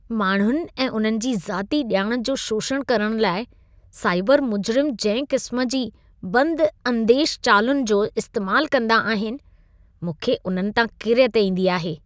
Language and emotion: Sindhi, disgusted